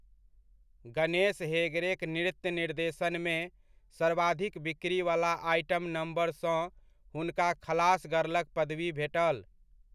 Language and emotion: Maithili, neutral